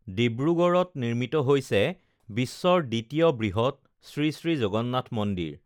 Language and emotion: Assamese, neutral